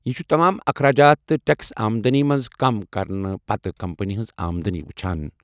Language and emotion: Kashmiri, neutral